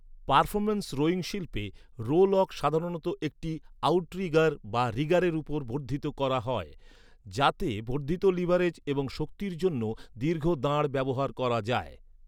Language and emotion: Bengali, neutral